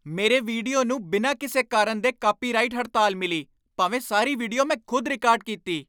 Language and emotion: Punjabi, angry